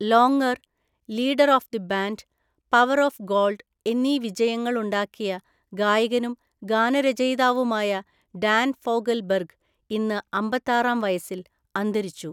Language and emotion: Malayalam, neutral